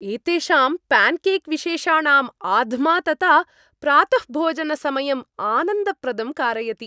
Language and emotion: Sanskrit, happy